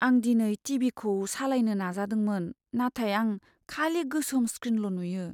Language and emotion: Bodo, sad